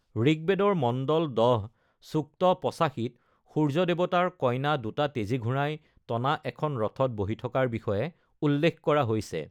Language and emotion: Assamese, neutral